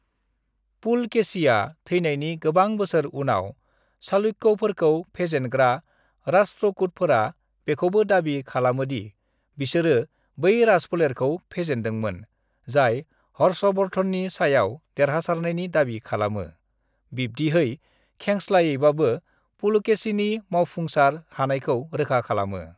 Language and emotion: Bodo, neutral